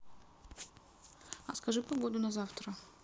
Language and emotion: Russian, neutral